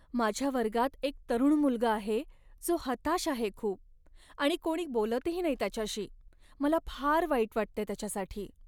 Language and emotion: Marathi, sad